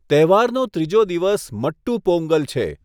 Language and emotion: Gujarati, neutral